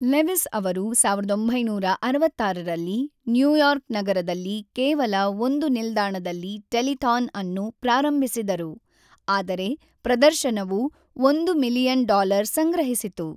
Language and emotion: Kannada, neutral